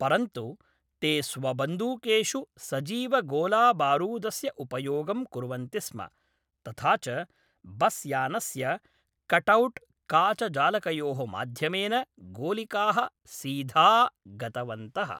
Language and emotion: Sanskrit, neutral